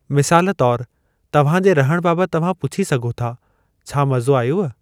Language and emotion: Sindhi, neutral